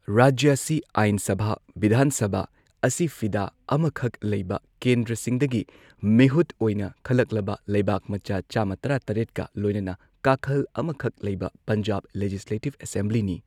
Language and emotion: Manipuri, neutral